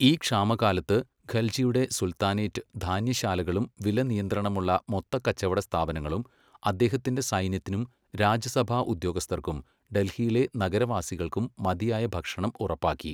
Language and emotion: Malayalam, neutral